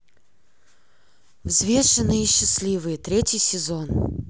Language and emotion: Russian, neutral